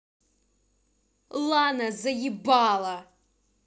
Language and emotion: Russian, angry